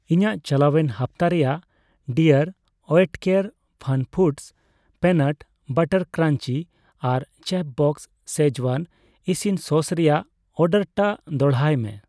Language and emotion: Santali, neutral